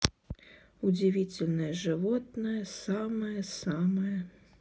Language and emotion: Russian, sad